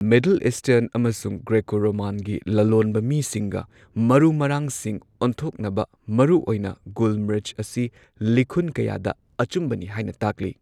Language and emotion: Manipuri, neutral